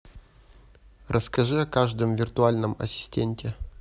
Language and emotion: Russian, neutral